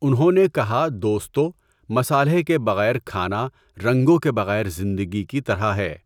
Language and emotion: Urdu, neutral